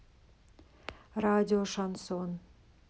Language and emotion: Russian, neutral